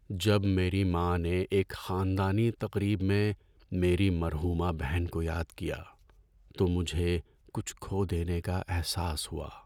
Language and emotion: Urdu, sad